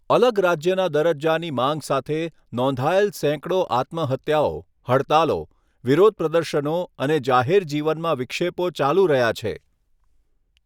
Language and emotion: Gujarati, neutral